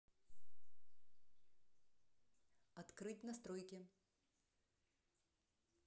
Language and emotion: Russian, neutral